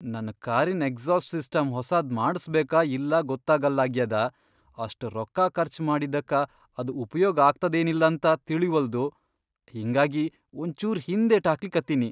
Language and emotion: Kannada, fearful